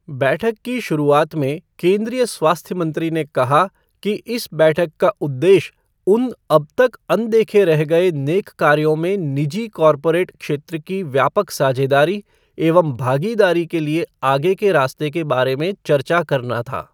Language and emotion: Hindi, neutral